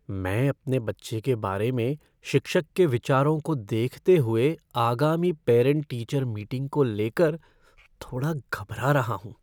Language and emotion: Hindi, fearful